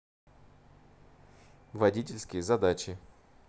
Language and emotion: Russian, neutral